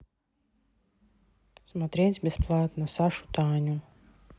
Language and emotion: Russian, neutral